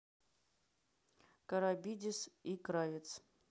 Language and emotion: Russian, neutral